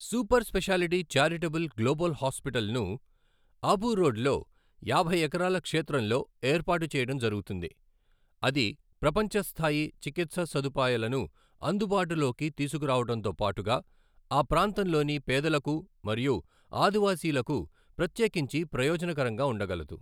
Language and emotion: Telugu, neutral